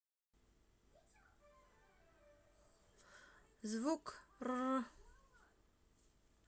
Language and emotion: Russian, neutral